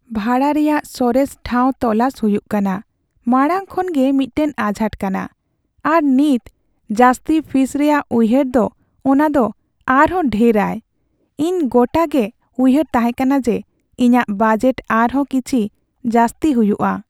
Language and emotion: Santali, sad